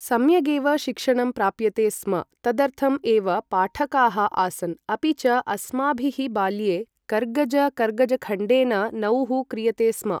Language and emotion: Sanskrit, neutral